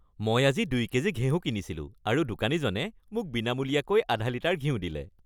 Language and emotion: Assamese, happy